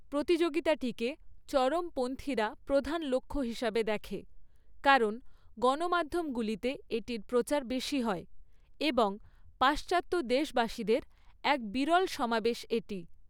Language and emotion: Bengali, neutral